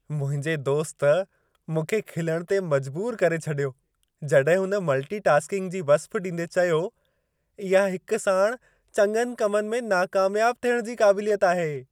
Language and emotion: Sindhi, happy